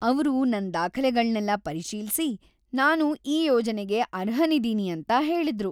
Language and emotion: Kannada, happy